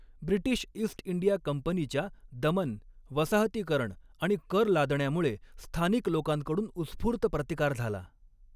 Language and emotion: Marathi, neutral